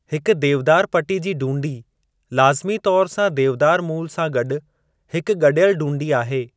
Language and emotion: Sindhi, neutral